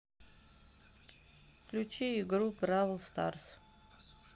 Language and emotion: Russian, neutral